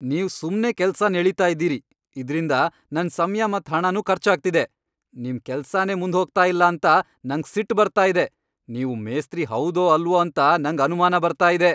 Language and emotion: Kannada, angry